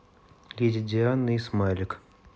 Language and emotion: Russian, neutral